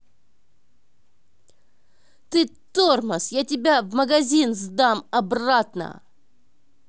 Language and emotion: Russian, angry